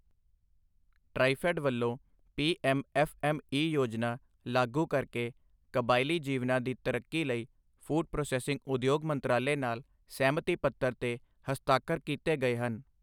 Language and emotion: Punjabi, neutral